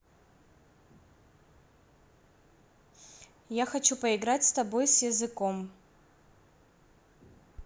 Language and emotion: Russian, neutral